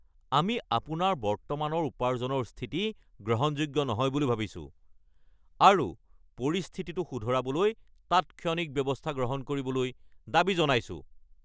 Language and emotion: Assamese, angry